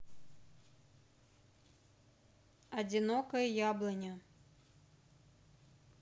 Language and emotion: Russian, neutral